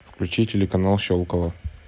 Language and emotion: Russian, neutral